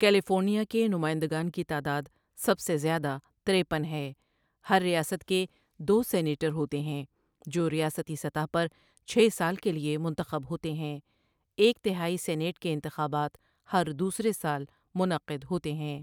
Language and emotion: Urdu, neutral